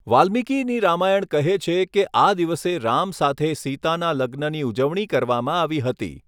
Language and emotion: Gujarati, neutral